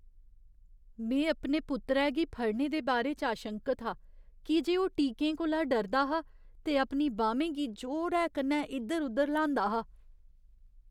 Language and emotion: Dogri, fearful